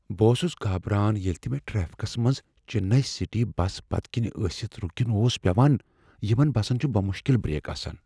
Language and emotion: Kashmiri, fearful